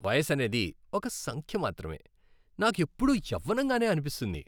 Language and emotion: Telugu, happy